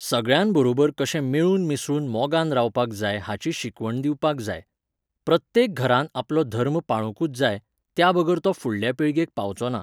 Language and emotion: Goan Konkani, neutral